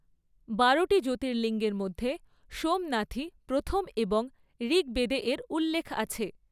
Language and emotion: Bengali, neutral